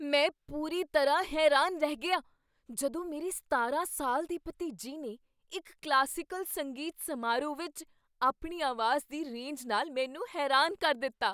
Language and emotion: Punjabi, surprised